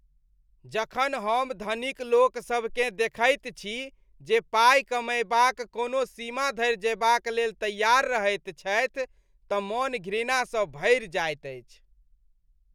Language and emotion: Maithili, disgusted